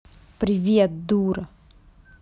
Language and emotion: Russian, angry